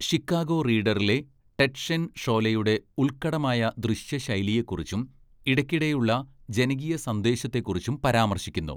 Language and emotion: Malayalam, neutral